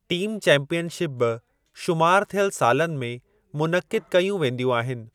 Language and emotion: Sindhi, neutral